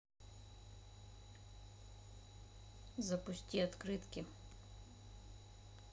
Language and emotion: Russian, neutral